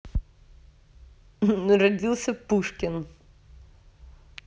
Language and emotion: Russian, positive